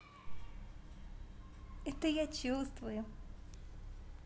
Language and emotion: Russian, positive